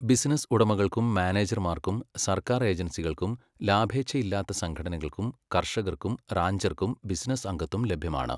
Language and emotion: Malayalam, neutral